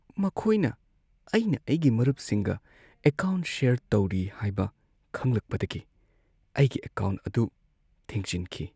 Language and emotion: Manipuri, sad